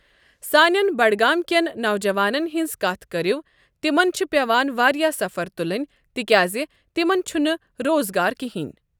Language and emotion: Kashmiri, neutral